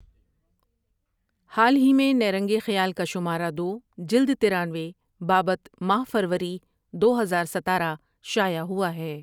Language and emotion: Urdu, neutral